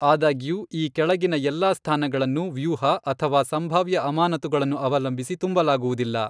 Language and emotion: Kannada, neutral